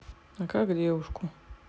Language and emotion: Russian, neutral